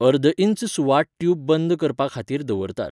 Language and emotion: Goan Konkani, neutral